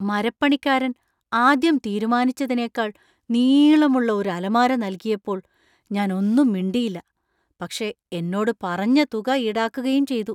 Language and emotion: Malayalam, surprised